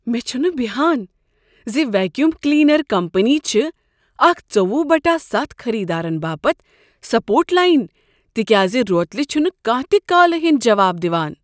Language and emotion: Kashmiri, surprised